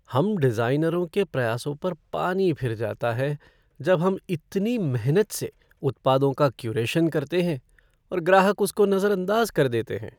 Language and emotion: Hindi, sad